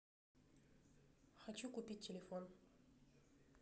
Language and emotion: Russian, neutral